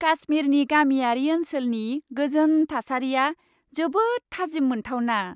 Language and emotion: Bodo, happy